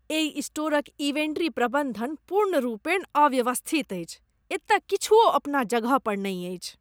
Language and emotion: Maithili, disgusted